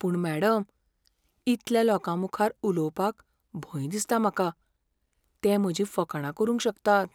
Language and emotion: Goan Konkani, fearful